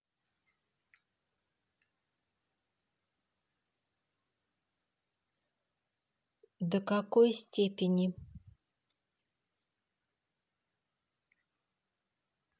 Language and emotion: Russian, neutral